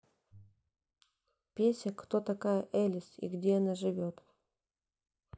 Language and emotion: Russian, neutral